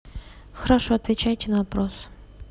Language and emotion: Russian, neutral